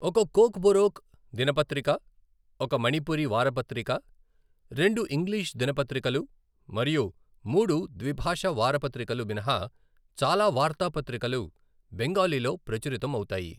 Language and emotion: Telugu, neutral